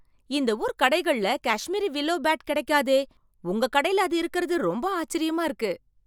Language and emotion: Tamil, surprised